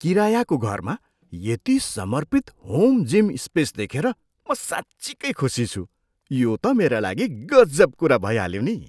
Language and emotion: Nepali, surprised